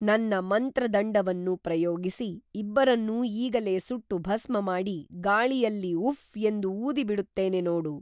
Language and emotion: Kannada, neutral